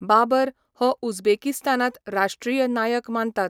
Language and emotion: Goan Konkani, neutral